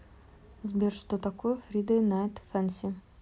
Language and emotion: Russian, neutral